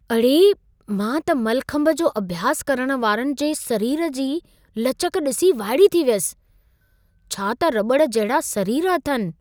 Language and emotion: Sindhi, surprised